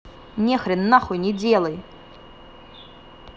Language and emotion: Russian, angry